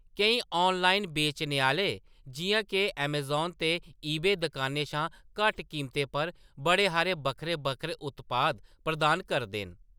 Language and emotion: Dogri, neutral